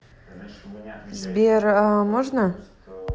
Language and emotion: Russian, neutral